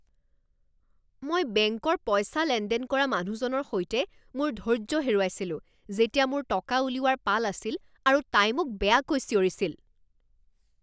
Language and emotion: Assamese, angry